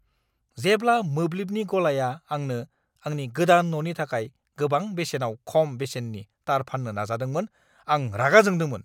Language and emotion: Bodo, angry